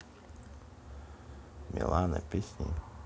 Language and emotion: Russian, neutral